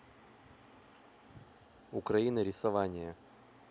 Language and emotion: Russian, neutral